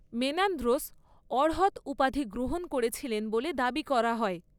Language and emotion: Bengali, neutral